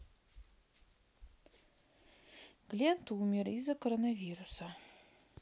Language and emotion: Russian, sad